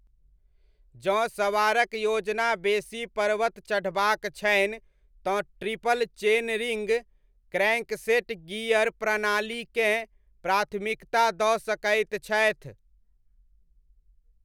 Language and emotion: Maithili, neutral